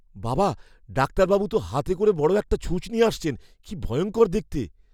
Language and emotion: Bengali, fearful